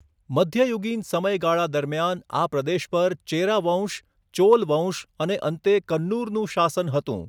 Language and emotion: Gujarati, neutral